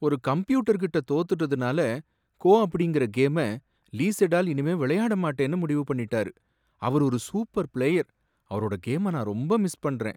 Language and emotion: Tamil, sad